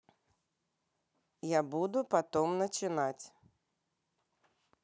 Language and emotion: Russian, neutral